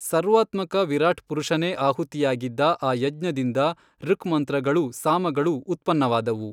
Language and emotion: Kannada, neutral